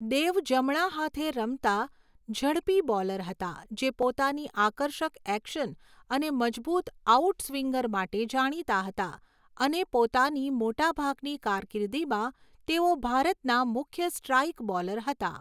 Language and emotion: Gujarati, neutral